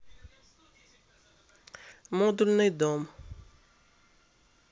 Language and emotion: Russian, neutral